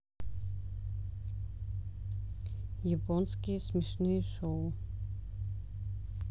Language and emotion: Russian, neutral